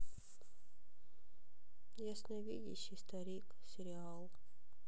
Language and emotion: Russian, sad